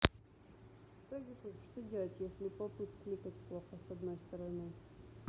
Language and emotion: Russian, neutral